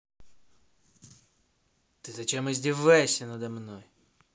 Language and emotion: Russian, angry